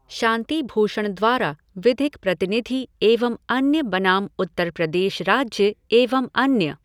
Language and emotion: Hindi, neutral